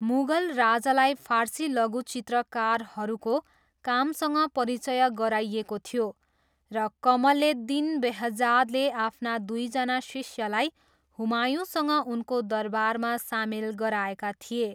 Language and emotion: Nepali, neutral